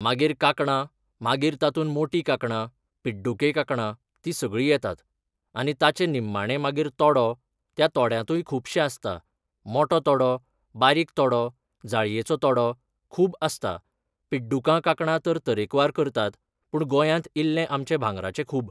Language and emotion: Goan Konkani, neutral